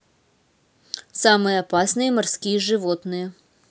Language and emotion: Russian, neutral